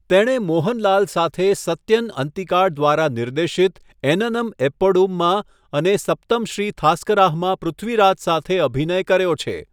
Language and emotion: Gujarati, neutral